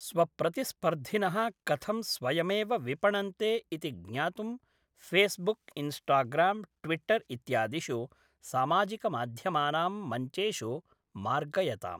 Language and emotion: Sanskrit, neutral